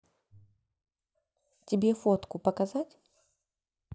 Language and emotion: Russian, neutral